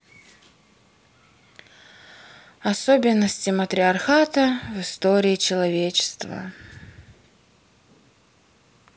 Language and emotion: Russian, sad